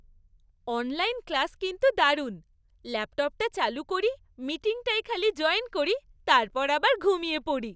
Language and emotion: Bengali, happy